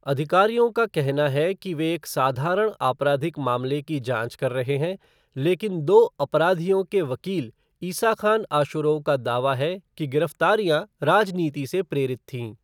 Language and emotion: Hindi, neutral